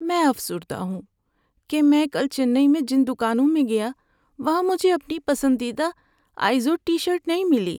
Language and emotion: Urdu, sad